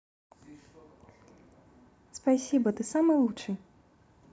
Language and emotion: Russian, positive